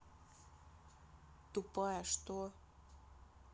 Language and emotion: Russian, angry